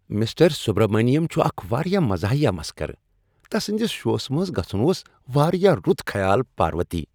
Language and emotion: Kashmiri, happy